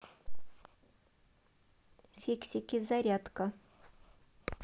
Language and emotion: Russian, neutral